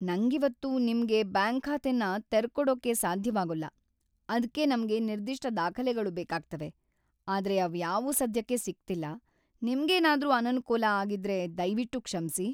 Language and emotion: Kannada, sad